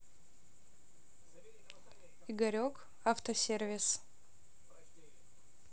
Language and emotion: Russian, neutral